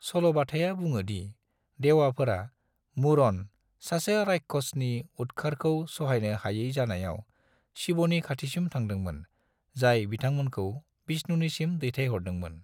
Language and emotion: Bodo, neutral